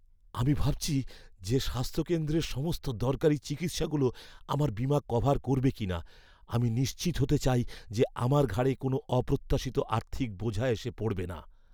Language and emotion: Bengali, fearful